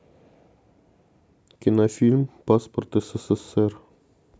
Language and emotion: Russian, neutral